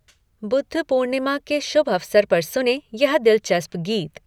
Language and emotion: Hindi, neutral